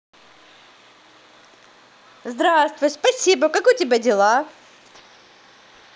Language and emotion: Russian, positive